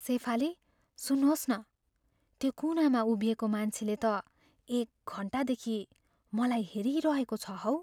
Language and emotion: Nepali, fearful